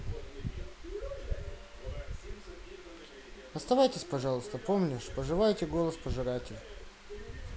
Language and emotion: Russian, neutral